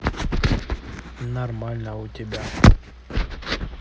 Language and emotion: Russian, neutral